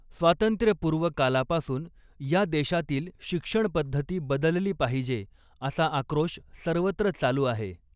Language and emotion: Marathi, neutral